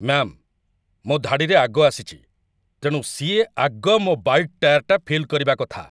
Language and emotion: Odia, angry